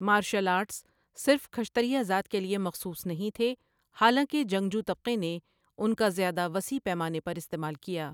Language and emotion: Urdu, neutral